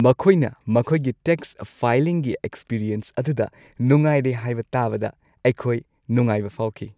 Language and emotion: Manipuri, happy